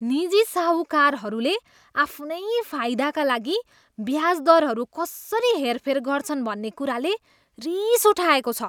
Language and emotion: Nepali, disgusted